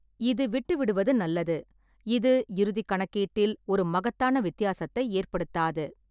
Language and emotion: Tamil, neutral